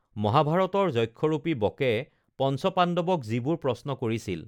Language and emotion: Assamese, neutral